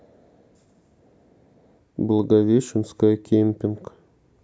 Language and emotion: Russian, neutral